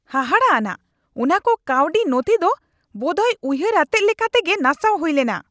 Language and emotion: Santali, angry